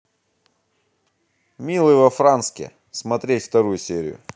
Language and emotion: Russian, positive